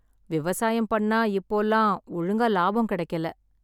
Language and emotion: Tamil, sad